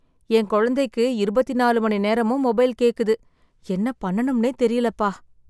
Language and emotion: Tamil, sad